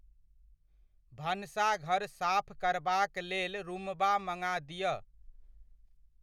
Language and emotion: Maithili, neutral